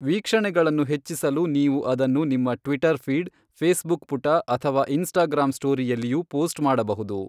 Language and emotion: Kannada, neutral